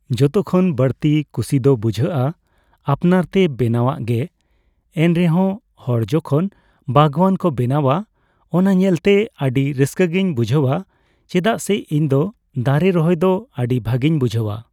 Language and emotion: Santali, neutral